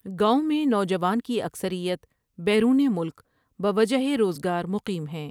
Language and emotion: Urdu, neutral